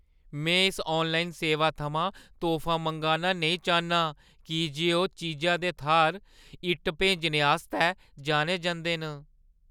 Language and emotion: Dogri, fearful